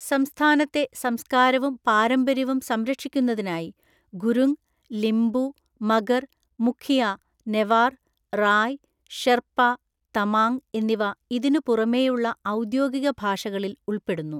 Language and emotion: Malayalam, neutral